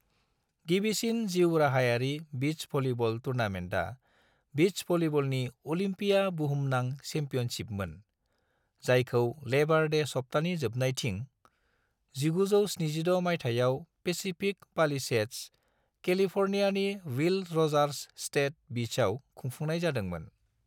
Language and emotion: Bodo, neutral